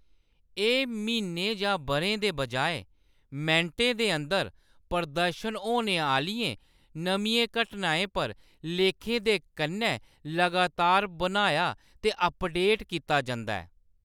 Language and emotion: Dogri, neutral